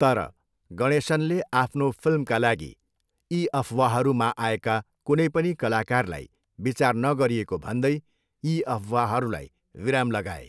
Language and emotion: Nepali, neutral